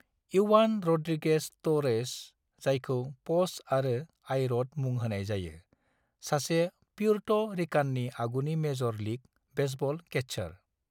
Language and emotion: Bodo, neutral